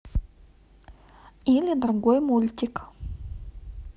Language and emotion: Russian, neutral